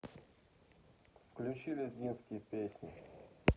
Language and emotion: Russian, neutral